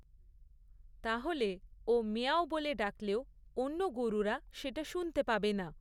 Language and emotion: Bengali, neutral